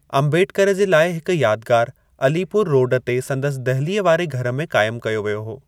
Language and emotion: Sindhi, neutral